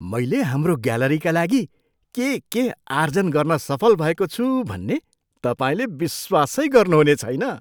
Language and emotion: Nepali, surprised